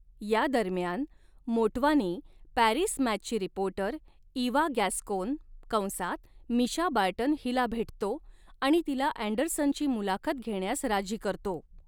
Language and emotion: Marathi, neutral